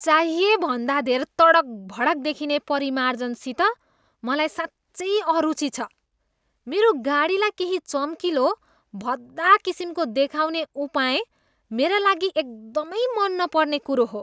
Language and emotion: Nepali, disgusted